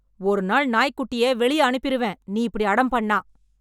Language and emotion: Tamil, angry